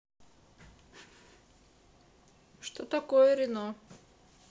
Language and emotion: Russian, neutral